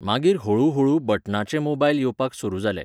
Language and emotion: Goan Konkani, neutral